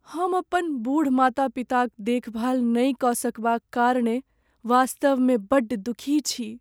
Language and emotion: Maithili, sad